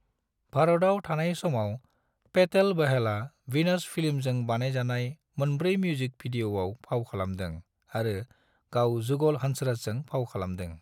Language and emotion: Bodo, neutral